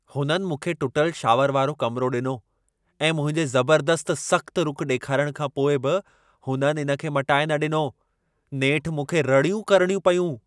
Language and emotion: Sindhi, angry